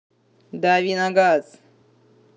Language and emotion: Russian, angry